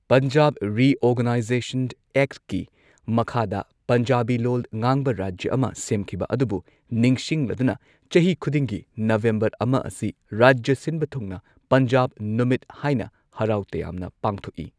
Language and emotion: Manipuri, neutral